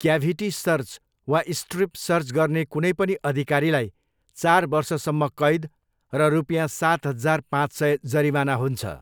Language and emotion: Nepali, neutral